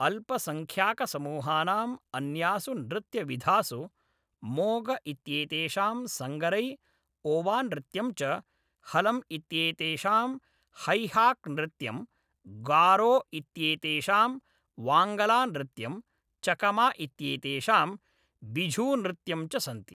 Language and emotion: Sanskrit, neutral